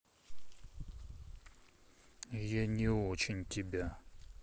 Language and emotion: Russian, sad